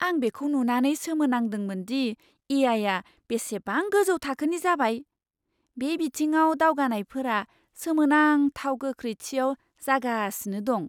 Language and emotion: Bodo, surprised